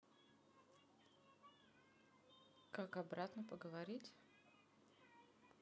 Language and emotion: Russian, neutral